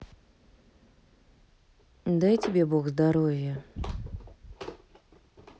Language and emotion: Russian, neutral